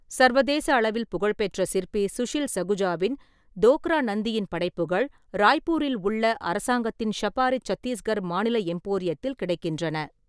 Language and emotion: Tamil, neutral